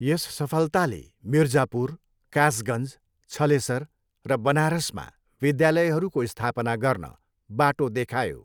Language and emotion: Nepali, neutral